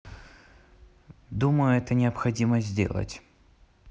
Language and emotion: Russian, neutral